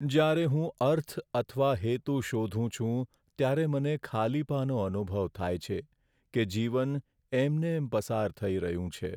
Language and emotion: Gujarati, sad